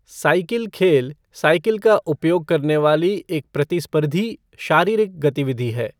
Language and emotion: Hindi, neutral